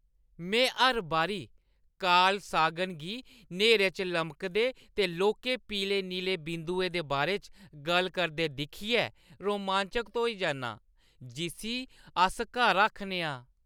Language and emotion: Dogri, happy